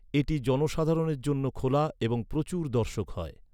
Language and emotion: Bengali, neutral